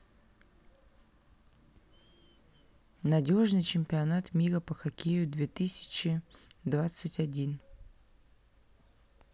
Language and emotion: Russian, neutral